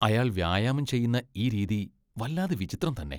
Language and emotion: Malayalam, disgusted